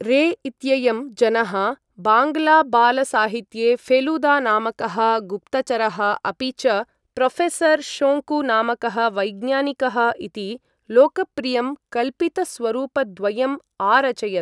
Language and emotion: Sanskrit, neutral